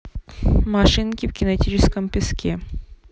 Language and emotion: Russian, neutral